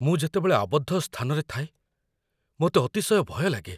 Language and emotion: Odia, fearful